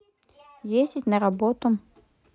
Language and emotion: Russian, neutral